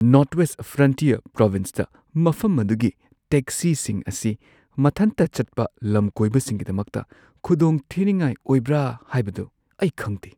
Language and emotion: Manipuri, fearful